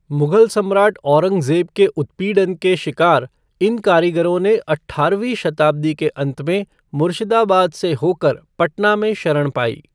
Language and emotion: Hindi, neutral